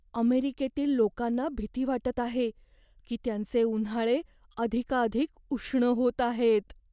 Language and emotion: Marathi, fearful